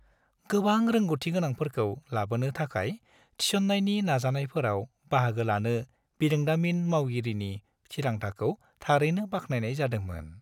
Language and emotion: Bodo, happy